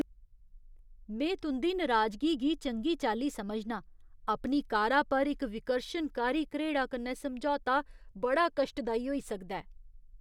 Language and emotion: Dogri, disgusted